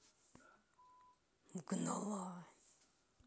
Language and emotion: Russian, neutral